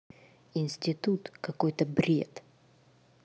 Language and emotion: Russian, angry